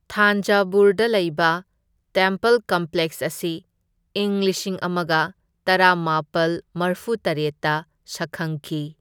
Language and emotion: Manipuri, neutral